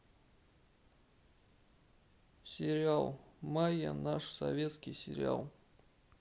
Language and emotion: Russian, sad